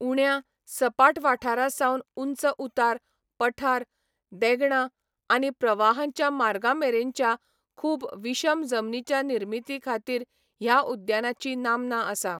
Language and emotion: Goan Konkani, neutral